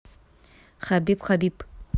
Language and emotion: Russian, neutral